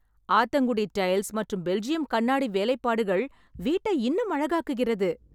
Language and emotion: Tamil, happy